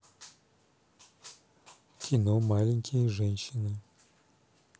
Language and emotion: Russian, neutral